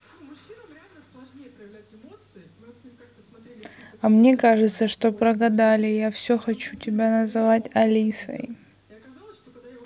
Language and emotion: Russian, sad